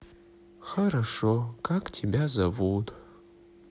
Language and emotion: Russian, sad